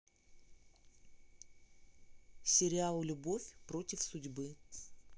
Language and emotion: Russian, neutral